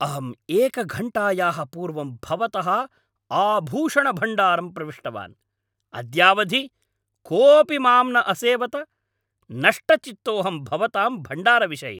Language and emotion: Sanskrit, angry